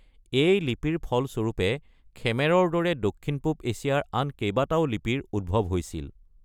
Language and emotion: Assamese, neutral